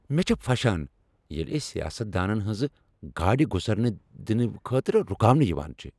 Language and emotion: Kashmiri, angry